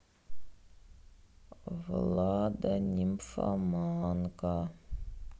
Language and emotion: Russian, sad